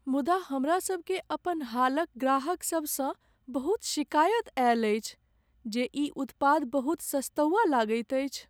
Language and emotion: Maithili, sad